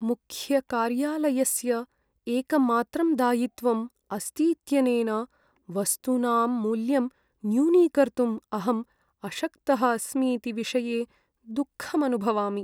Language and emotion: Sanskrit, sad